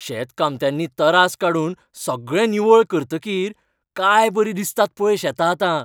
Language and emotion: Goan Konkani, happy